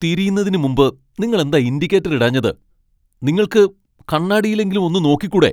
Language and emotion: Malayalam, angry